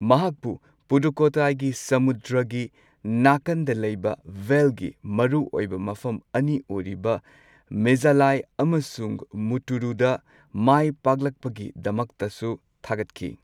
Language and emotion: Manipuri, neutral